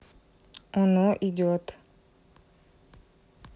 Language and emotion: Russian, neutral